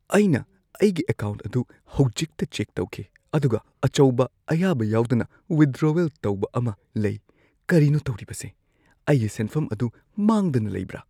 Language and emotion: Manipuri, fearful